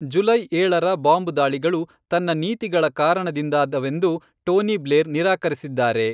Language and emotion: Kannada, neutral